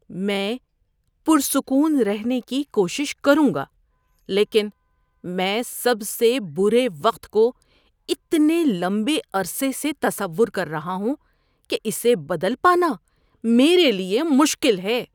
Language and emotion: Urdu, disgusted